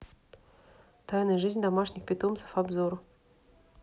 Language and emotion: Russian, neutral